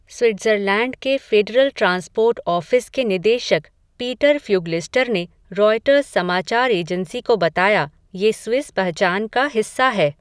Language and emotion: Hindi, neutral